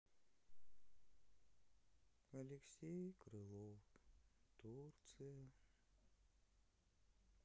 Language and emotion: Russian, sad